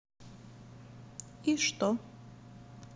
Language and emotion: Russian, neutral